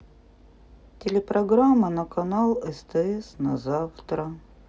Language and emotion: Russian, sad